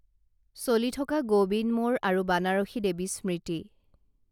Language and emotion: Assamese, neutral